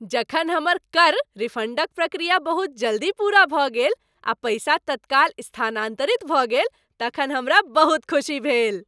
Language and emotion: Maithili, happy